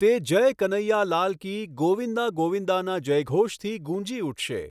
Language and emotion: Gujarati, neutral